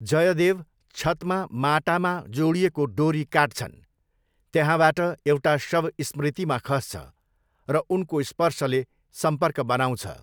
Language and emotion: Nepali, neutral